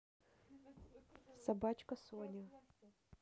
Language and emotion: Russian, neutral